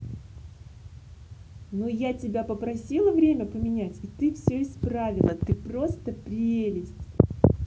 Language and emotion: Russian, positive